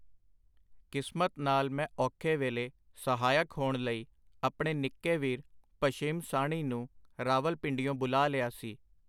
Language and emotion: Punjabi, neutral